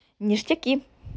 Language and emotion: Russian, positive